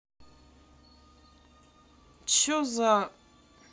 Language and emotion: Russian, angry